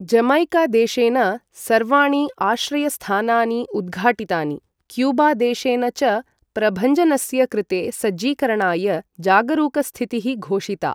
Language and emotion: Sanskrit, neutral